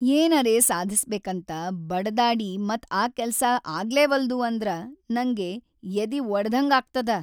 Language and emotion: Kannada, sad